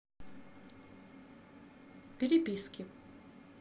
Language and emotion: Russian, neutral